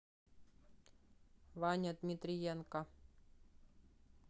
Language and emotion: Russian, neutral